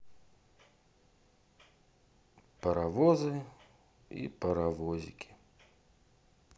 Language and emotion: Russian, sad